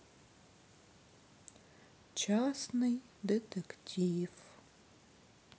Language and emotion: Russian, sad